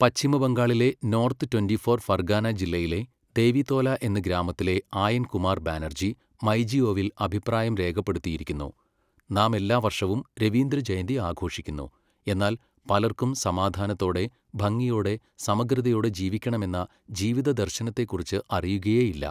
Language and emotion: Malayalam, neutral